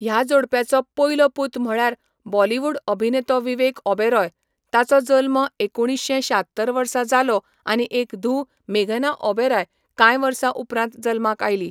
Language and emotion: Goan Konkani, neutral